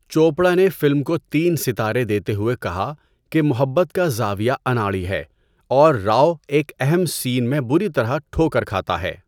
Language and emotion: Urdu, neutral